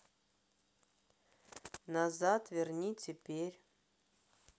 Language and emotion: Russian, neutral